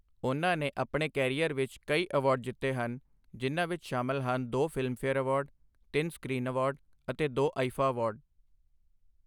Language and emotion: Punjabi, neutral